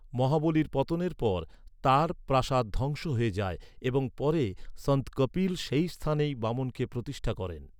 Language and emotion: Bengali, neutral